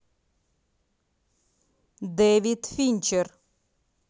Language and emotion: Russian, neutral